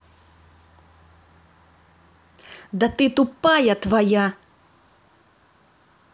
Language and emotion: Russian, angry